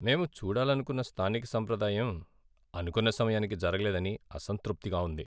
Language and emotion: Telugu, sad